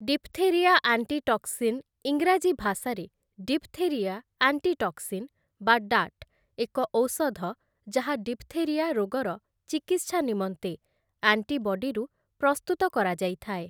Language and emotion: Odia, neutral